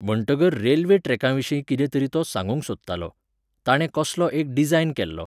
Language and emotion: Goan Konkani, neutral